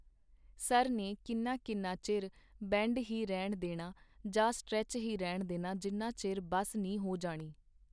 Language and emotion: Punjabi, neutral